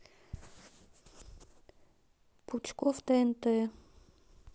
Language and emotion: Russian, neutral